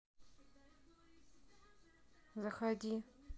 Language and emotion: Russian, neutral